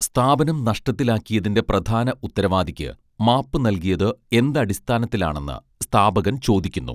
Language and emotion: Malayalam, neutral